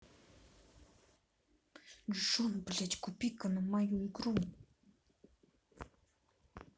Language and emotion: Russian, angry